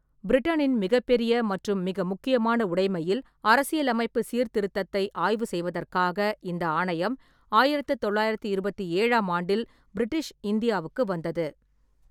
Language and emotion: Tamil, neutral